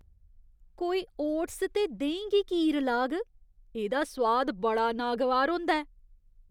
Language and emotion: Dogri, disgusted